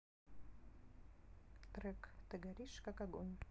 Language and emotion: Russian, neutral